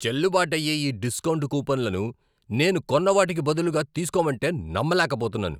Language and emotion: Telugu, angry